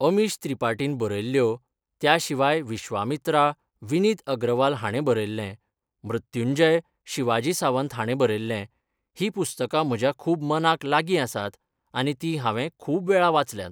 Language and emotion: Goan Konkani, neutral